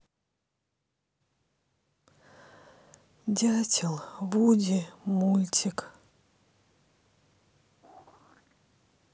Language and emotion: Russian, sad